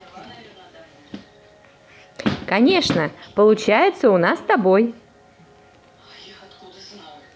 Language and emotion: Russian, positive